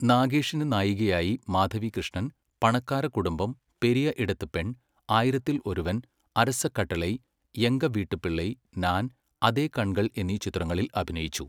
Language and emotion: Malayalam, neutral